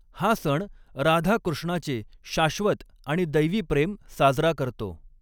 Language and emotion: Marathi, neutral